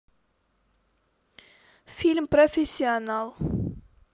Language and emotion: Russian, neutral